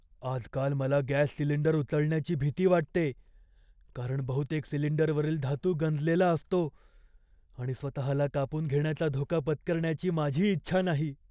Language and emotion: Marathi, fearful